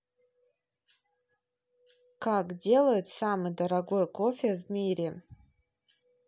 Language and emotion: Russian, neutral